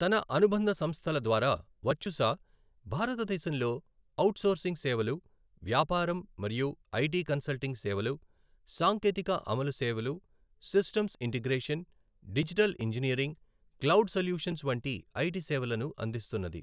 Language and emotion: Telugu, neutral